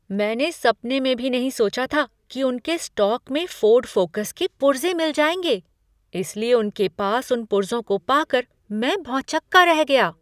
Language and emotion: Hindi, surprised